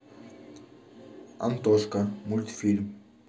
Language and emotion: Russian, neutral